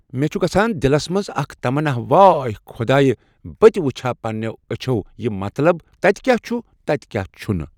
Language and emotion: Kashmiri, neutral